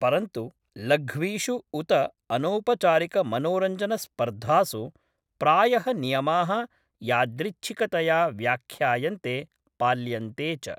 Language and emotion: Sanskrit, neutral